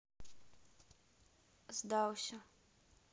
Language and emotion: Russian, neutral